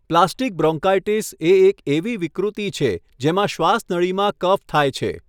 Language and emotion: Gujarati, neutral